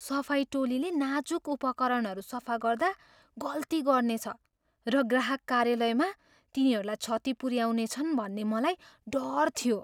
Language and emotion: Nepali, fearful